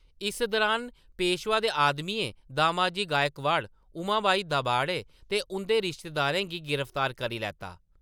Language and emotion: Dogri, neutral